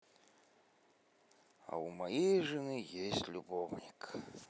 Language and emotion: Russian, positive